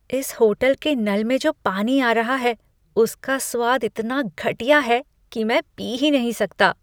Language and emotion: Hindi, disgusted